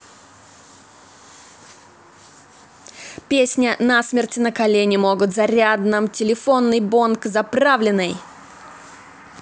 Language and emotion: Russian, positive